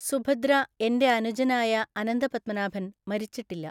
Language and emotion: Malayalam, neutral